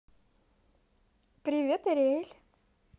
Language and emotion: Russian, positive